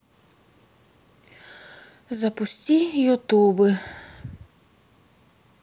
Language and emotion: Russian, sad